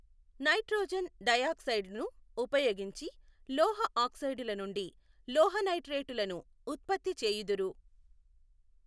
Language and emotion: Telugu, neutral